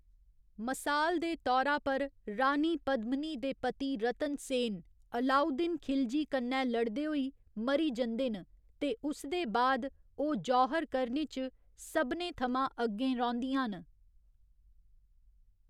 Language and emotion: Dogri, neutral